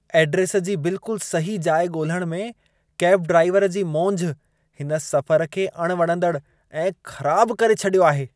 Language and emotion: Sindhi, disgusted